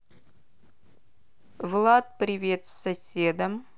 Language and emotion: Russian, neutral